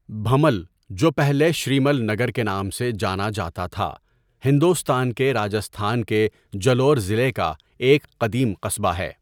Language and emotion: Urdu, neutral